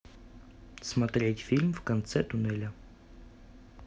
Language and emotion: Russian, neutral